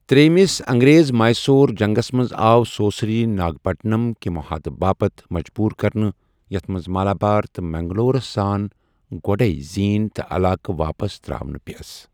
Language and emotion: Kashmiri, neutral